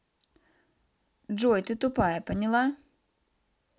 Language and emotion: Russian, angry